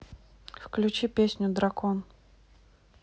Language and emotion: Russian, neutral